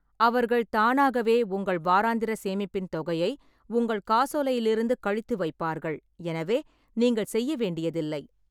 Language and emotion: Tamil, neutral